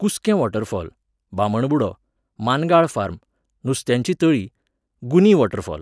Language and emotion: Goan Konkani, neutral